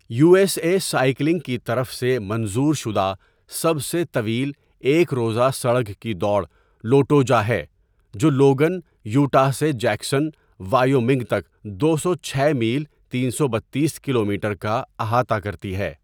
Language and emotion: Urdu, neutral